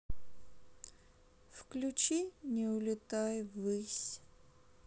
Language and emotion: Russian, sad